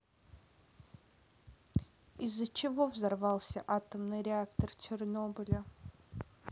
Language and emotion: Russian, neutral